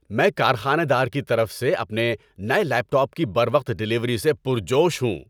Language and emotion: Urdu, happy